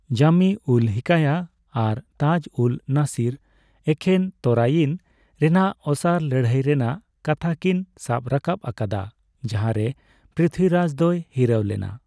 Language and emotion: Santali, neutral